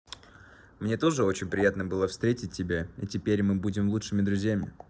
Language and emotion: Russian, positive